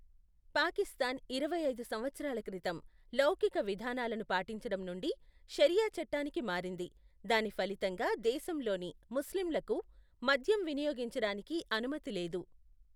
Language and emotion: Telugu, neutral